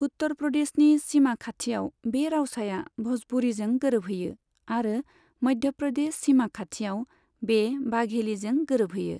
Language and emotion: Bodo, neutral